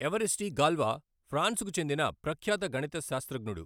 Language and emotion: Telugu, neutral